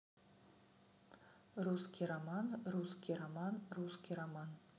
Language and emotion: Russian, neutral